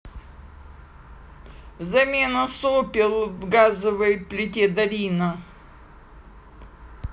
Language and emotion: Russian, neutral